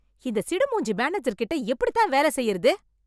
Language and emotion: Tamil, angry